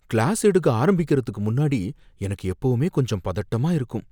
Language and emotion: Tamil, fearful